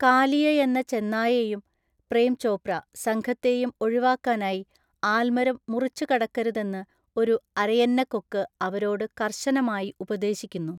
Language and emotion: Malayalam, neutral